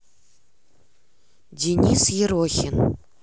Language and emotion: Russian, neutral